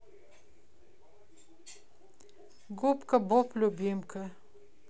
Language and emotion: Russian, neutral